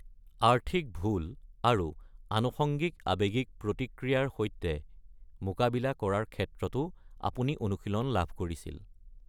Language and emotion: Assamese, neutral